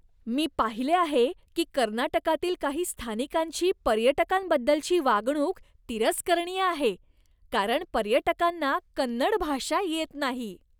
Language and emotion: Marathi, disgusted